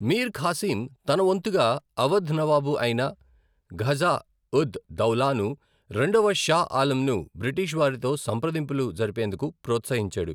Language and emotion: Telugu, neutral